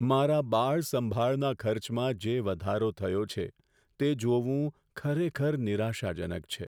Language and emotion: Gujarati, sad